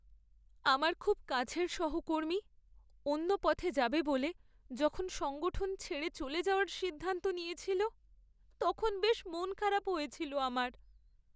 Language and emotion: Bengali, sad